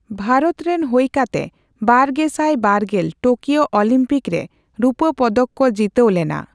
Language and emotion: Santali, neutral